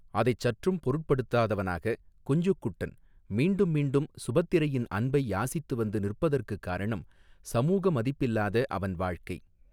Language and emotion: Tamil, neutral